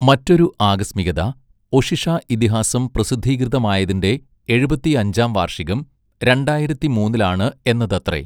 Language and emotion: Malayalam, neutral